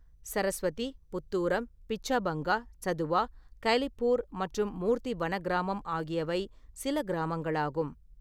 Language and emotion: Tamil, neutral